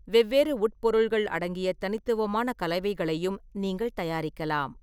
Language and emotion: Tamil, neutral